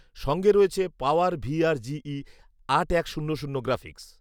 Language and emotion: Bengali, neutral